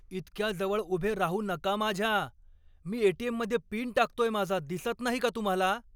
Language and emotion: Marathi, angry